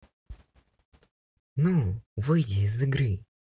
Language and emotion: Russian, neutral